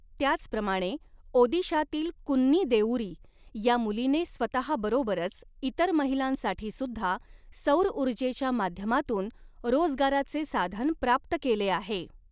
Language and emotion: Marathi, neutral